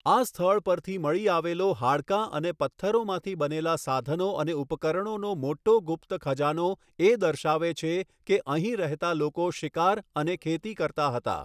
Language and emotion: Gujarati, neutral